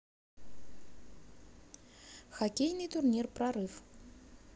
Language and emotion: Russian, neutral